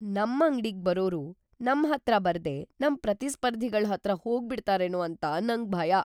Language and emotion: Kannada, fearful